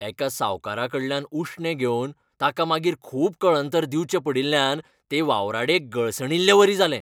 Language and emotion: Goan Konkani, angry